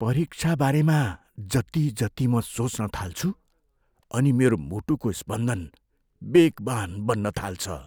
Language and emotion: Nepali, fearful